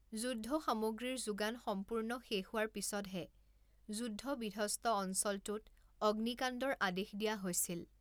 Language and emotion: Assamese, neutral